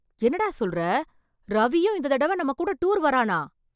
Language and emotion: Tamil, surprised